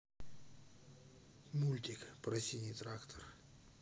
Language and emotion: Russian, neutral